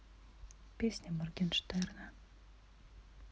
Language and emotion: Russian, neutral